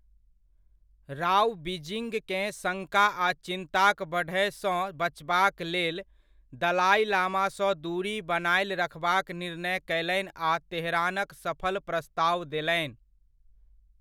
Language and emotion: Maithili, neutral